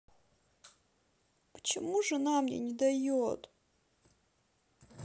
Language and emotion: Russian, sad